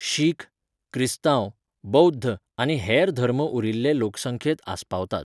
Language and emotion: Goan Konkani, neutral